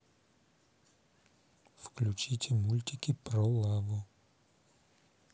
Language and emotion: Russian, neutral